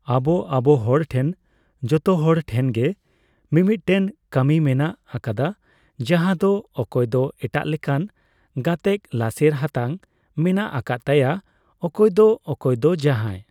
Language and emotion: Santali, neutral